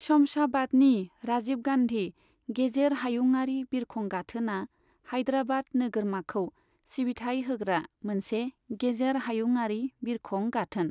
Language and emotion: Bodo, neutral